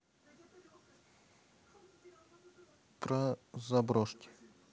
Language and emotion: Russian, neutral